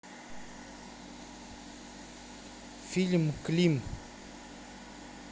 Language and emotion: Russian, neutral